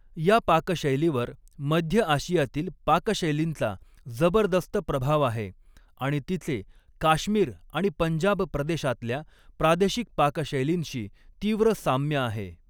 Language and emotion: Marathi, neutral